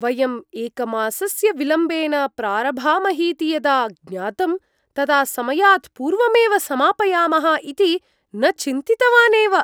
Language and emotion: Sanskrit, surprised